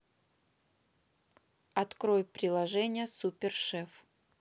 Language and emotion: Russian, neutral